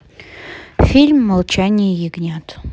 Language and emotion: Russian, neutral